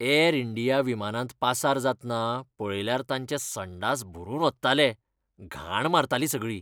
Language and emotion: Goan Konkani, disgusted